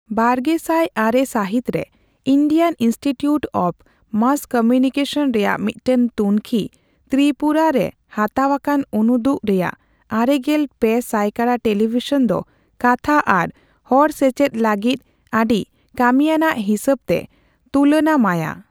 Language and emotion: Santali, neutral